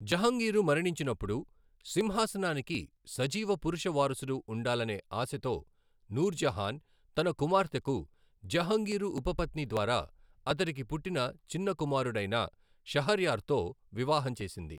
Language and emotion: Telugu, neutral